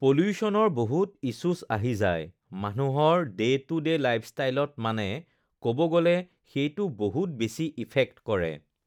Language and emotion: Assamese, neutral